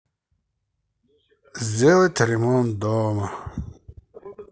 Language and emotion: Russian, sad